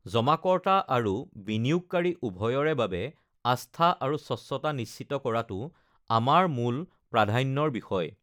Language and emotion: Assamese, neutral